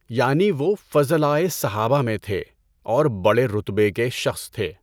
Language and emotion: Urdu, neutral